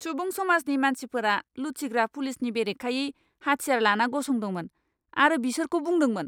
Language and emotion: Bodo, angry